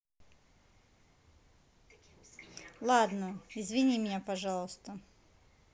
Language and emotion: Russian, neutral